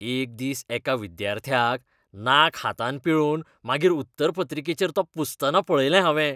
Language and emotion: Goan Konkani, disgusted